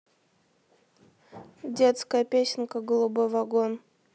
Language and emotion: Russian, neutral